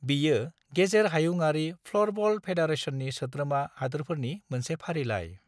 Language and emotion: Bodo, neutral